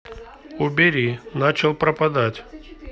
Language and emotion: Russian, neutral